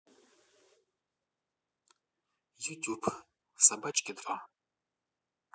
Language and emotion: Russian, neutral